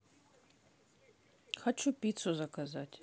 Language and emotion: Russian, neutral